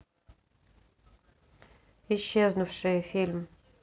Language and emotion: Russian, neutral